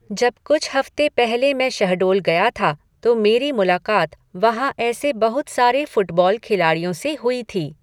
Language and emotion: Hindi, neutral